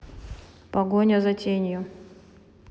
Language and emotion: Russian, neutral